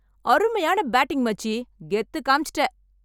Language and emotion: Tamil, happy